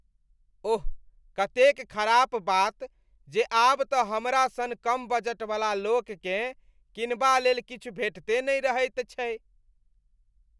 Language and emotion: Maithili, disgusted